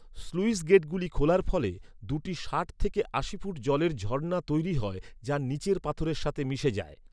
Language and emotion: Bengali, neutral